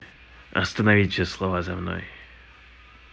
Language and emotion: Russian, neutral